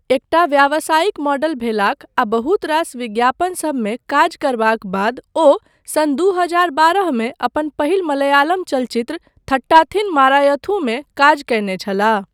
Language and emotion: Maithili, neutral